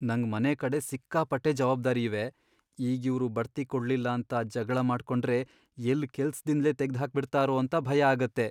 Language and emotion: Kannada, fearful